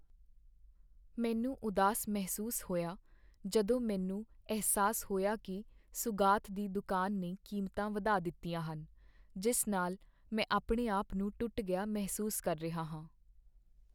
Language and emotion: Punjabi, sad